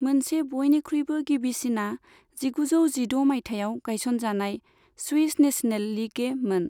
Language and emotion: Bodo, neutral